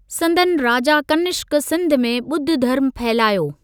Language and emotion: Sindhi, neutral